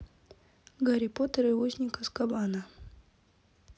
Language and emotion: Russian, neutral